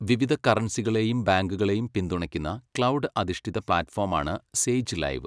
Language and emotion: Malayalam, neutral